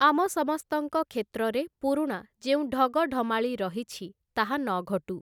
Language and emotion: Odia, neutral